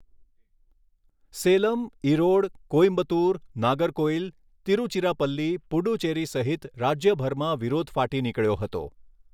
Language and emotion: Gujarati, neutral